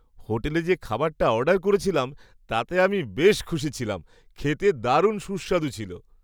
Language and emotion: Bengali, happy